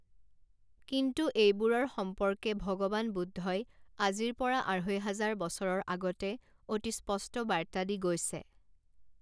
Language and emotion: Assamese, neutral